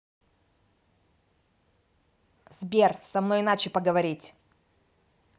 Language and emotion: Russian, angry